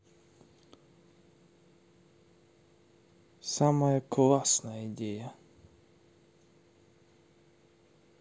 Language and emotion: Russian, neutral